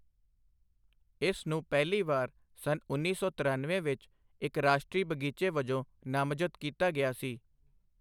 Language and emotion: Punjabi, neutral